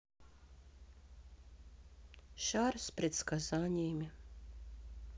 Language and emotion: Russian, sad